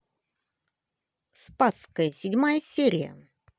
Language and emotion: Russian, positive